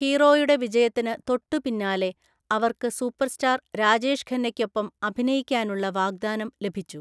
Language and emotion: Malayalam, neutral